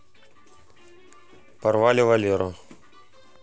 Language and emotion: Russian, neutral